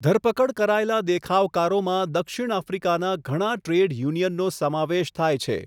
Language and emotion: Gujarati, neutral